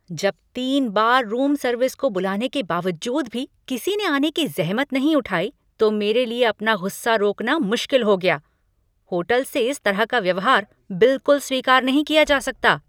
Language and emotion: Hindi, angry